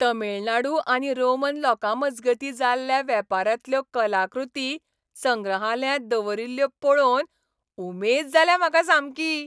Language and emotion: Goan Konkani, happy